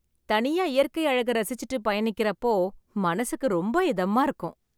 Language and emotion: Tamil, happy